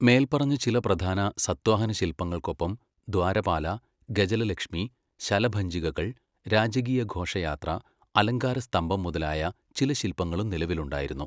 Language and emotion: Malayalam, neutral